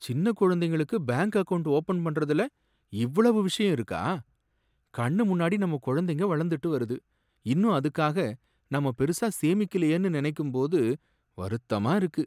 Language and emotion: Tamil, sad